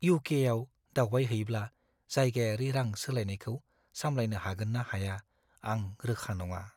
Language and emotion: Bodo, fearful